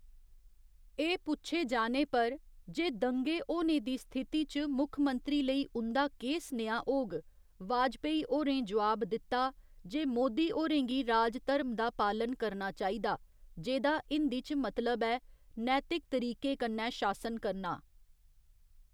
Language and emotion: Dogri, neutral